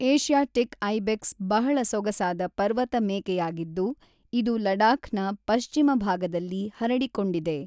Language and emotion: Kannada, neutral